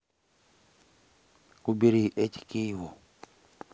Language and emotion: Russian, neutral